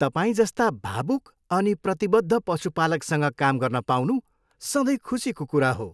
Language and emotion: Nepali, happy